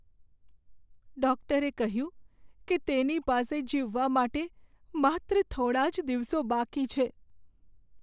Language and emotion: Gujarati, sad